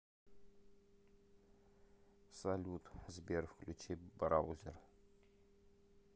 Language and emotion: Russian, neutral